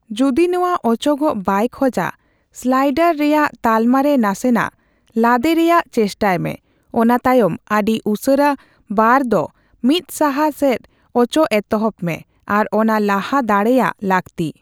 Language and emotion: Santali, neutral